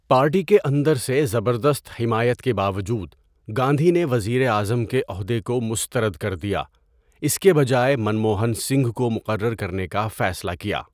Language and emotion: Urdu, neutral